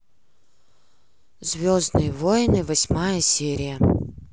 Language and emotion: Russian, neutral